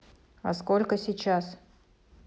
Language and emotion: Russian, neutral